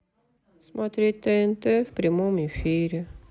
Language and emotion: Russian, sad